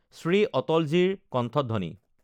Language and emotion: Assamese, neutral